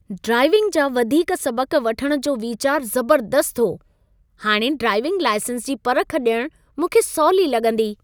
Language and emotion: Sindhi, happy